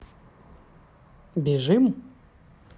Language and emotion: Russian, neutral